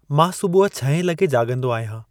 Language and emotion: Sindhi, neutral